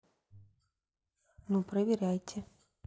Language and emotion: Russian, neutral